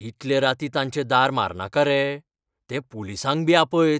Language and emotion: Goan Konkani, fearful